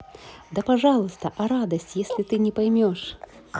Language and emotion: Russian, positive